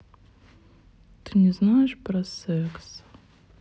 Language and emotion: Russian, sad